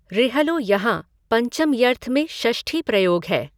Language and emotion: Hindi, neutral